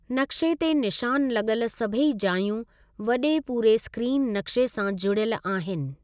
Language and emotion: Sindhi, neutral